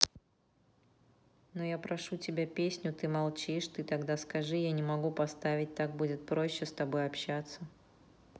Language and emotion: Russian, neutral